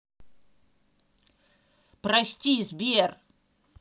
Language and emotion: Russian, angry